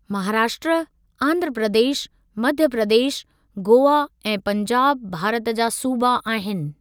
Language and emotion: Sindhi, neutral